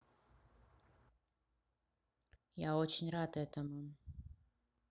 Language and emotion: Russian, neutral